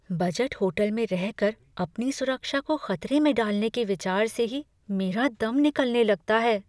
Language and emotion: Hindi, fearful